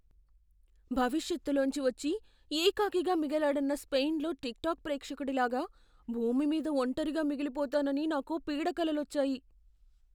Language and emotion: Telugu, fearful